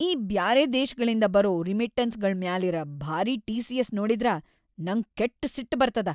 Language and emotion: Kannada, angry